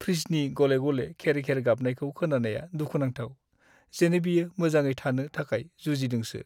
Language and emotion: Bodo, sad